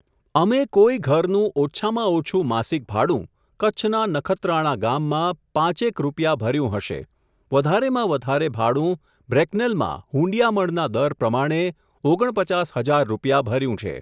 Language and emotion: Gujarati, neutral